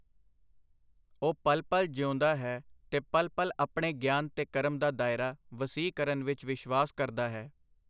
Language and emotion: Punjabi, neutral